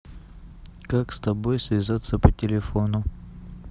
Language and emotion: Russian, neutral